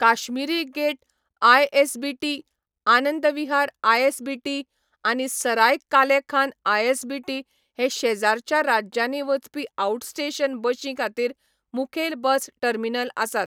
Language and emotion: Goan Konkani, neutral